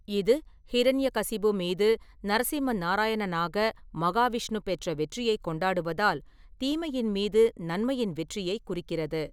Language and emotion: Tamil, neutral